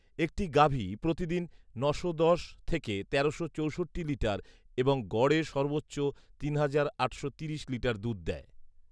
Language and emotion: Bengali, neutral